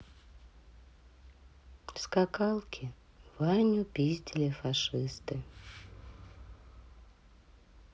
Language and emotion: Russian, sad